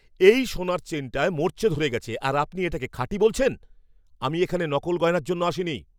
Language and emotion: Bengali, angry